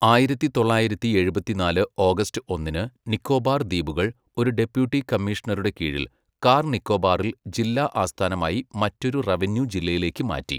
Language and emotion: Malayalam, neutral